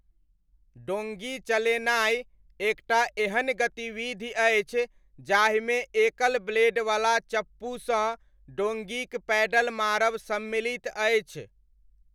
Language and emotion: Maithili, neutral